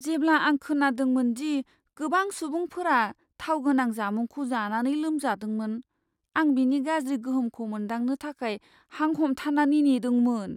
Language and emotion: Bodo, fearful